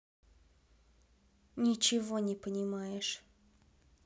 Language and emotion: Russian, sad